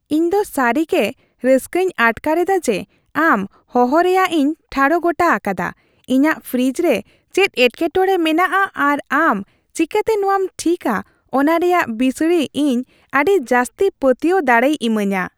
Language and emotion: Santali, happy